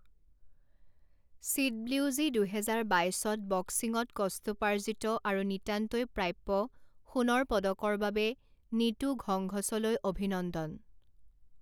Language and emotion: Assamese, neutral